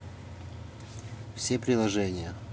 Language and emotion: Russian, neutral